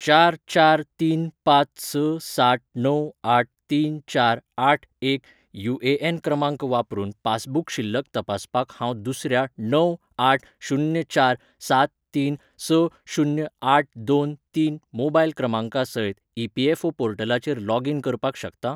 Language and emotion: Goan Konkani, neutral